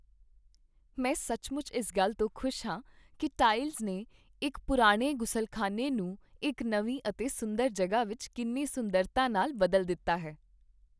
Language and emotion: Punjabi, happy